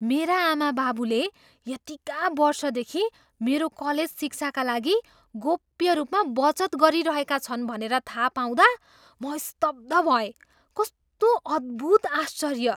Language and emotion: Nepali, surprised